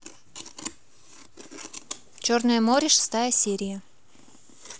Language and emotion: Russian, positive